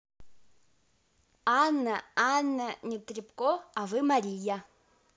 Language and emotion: Russian, positive